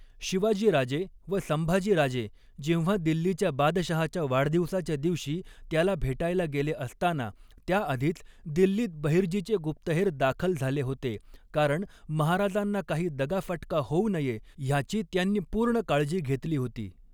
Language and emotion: Marathi, neutral